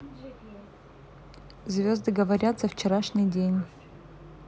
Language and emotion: Russian, neutral